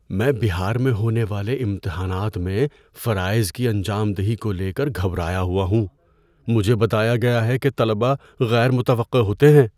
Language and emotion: Urdu, fearful